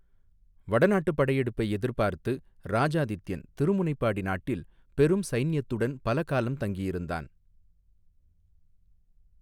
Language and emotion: Tamil, neutral